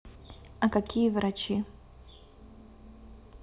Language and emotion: Russian, neutral